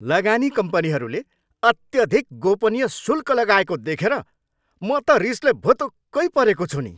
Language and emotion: Nepali, angry